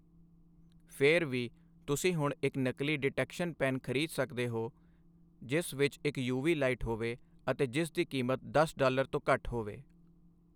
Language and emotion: Punjabi, neutral